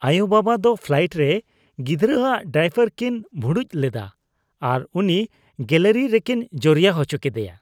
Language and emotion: Santali, disgusted